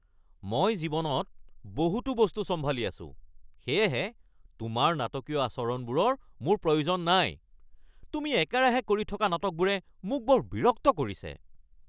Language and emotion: Assamese, angry